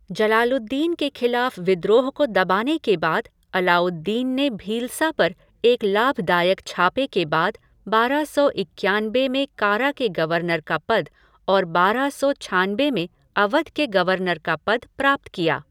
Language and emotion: Hindi, neutral